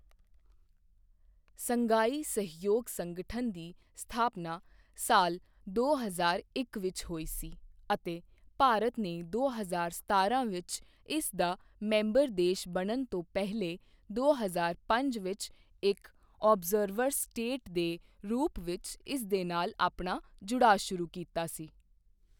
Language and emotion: Punjabi, neutral